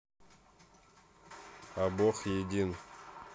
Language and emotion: Russian, neutral